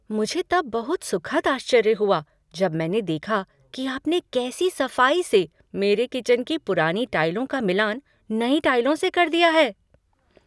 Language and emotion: Hindi, surprised